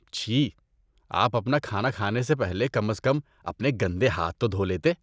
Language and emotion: Urdu, disgusted